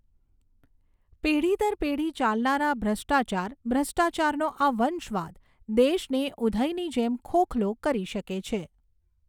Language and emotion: Gujarati, neutral